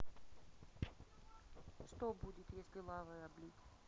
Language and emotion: Russian, neutral